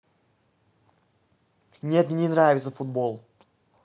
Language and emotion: Russian, angry